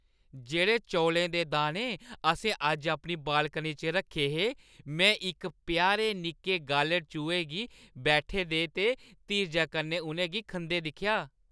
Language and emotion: Dogri, happy